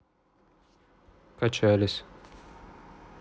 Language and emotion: Russian, neutral